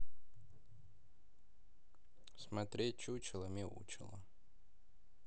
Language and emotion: Russian, neutral